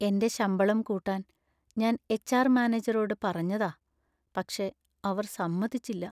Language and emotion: Malayalam, sad